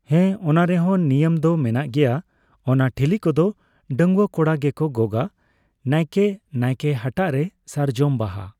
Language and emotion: Santali, neutral